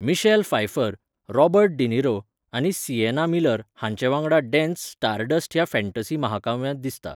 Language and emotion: Goan Konkani, neutral